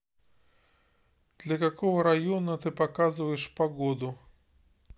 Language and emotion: Russian, neutral